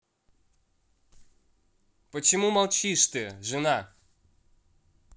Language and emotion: Russian, angry